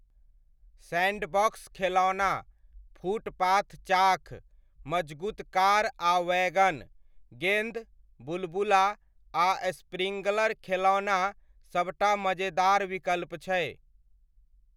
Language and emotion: Maithili, neutral